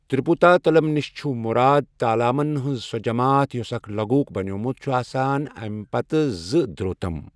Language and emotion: Kashmiri, neutral